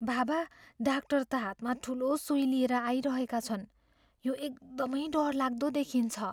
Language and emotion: Nepali, fearful